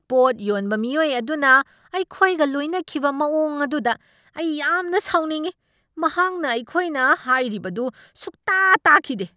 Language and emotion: Manipuri, angry